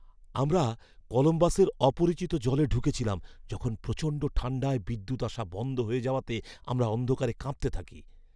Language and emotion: Bengali, fearful